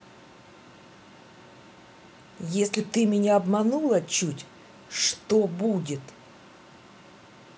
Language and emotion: Russian, angry